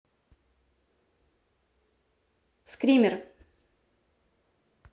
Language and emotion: Russian, neutral